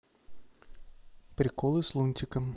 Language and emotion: Russian, neutral